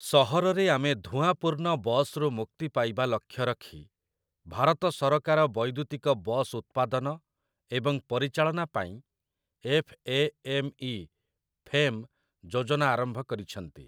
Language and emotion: Odia, neutral